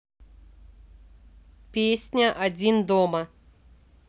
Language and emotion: Russian, neutral